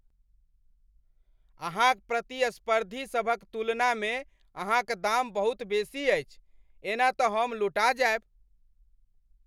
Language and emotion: Maithili, angry